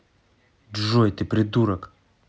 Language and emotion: Russian, angry